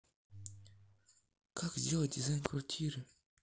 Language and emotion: Russian, neutral